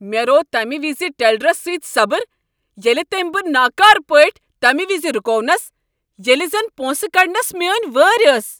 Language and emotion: Kashmiri, angry